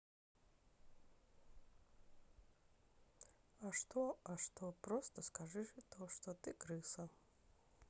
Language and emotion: Russian, sad